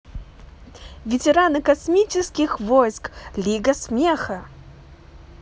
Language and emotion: Russian, positive